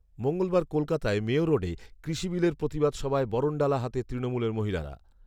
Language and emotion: Bengali, neutral